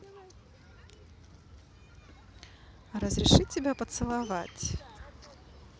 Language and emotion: Russian, positive